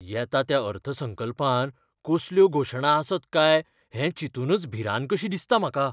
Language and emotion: Goan Konkani, fearful